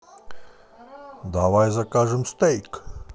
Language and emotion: Russian, positive